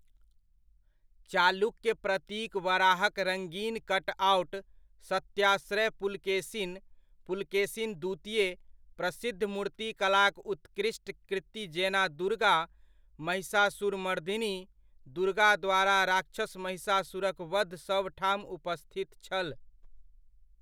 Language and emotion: Maithili, neutral